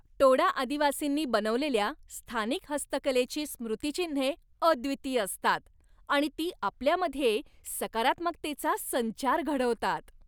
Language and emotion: Marathi, happy